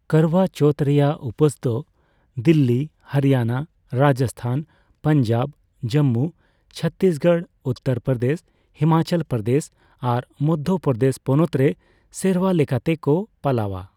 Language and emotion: Santali, neutral